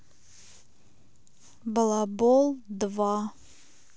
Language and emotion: Russian, neutral